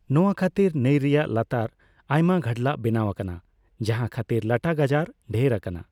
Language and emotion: Santali, neutral